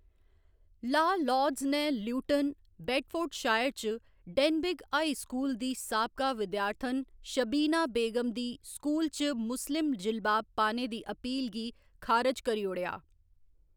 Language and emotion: Dogri, neutral